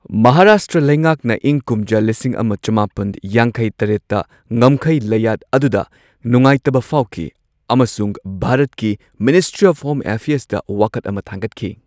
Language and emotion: Manipuri, neutral